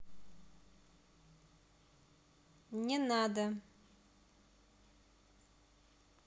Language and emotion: Russian, neutral